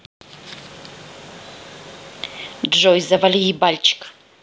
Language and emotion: Russian, angry